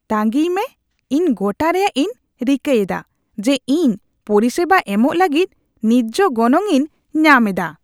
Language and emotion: Santali, disgusted